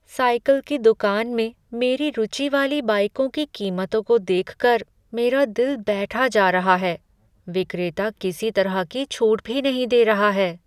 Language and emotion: Hindi, sad